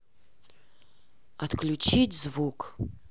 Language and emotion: Russian, neutral